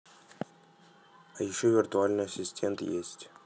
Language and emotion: Russian, neutral